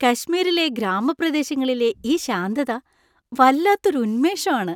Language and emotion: Malayalam, happy